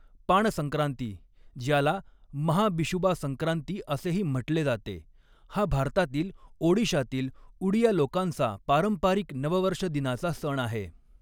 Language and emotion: Marathi, neutral